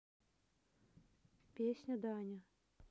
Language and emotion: Russian, neutral